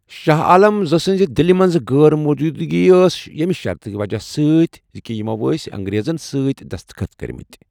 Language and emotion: Kashmiri, neutral